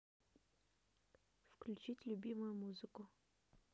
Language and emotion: Russian, neutral